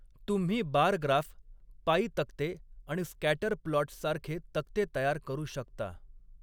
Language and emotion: Marathi, neutral